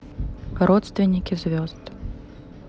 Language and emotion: Russian, neutral